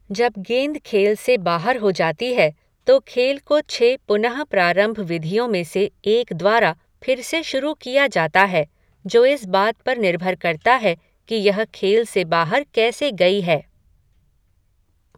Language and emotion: Hindi, neutral